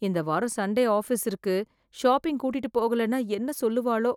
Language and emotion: Tamil, fearful